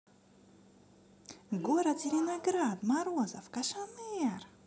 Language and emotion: Russian, positive